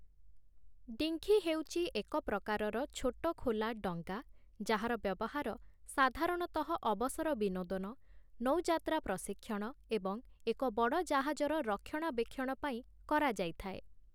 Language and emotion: Odia, neutral